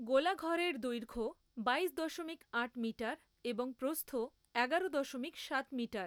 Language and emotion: Bengali, neutral